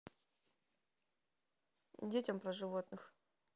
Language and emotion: Russian, neutral